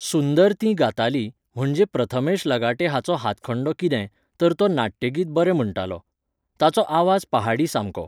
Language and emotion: Goan Konkani, neutral